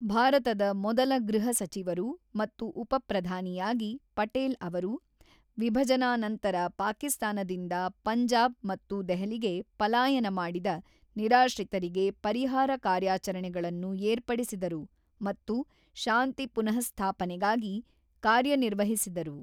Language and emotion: Kannada, neutral